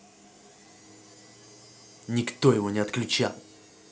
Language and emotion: Russian, angry